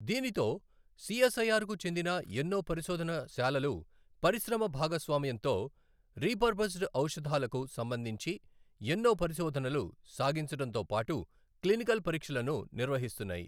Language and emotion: Telugu, neutral